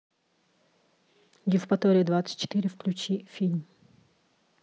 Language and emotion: Russian, neutral